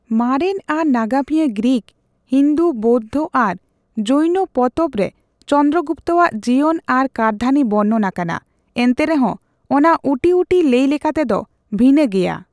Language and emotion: Santali, neutral